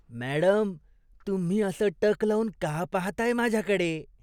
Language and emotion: Marathi, disgusted